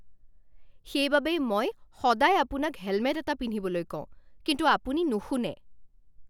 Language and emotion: Assamese, angry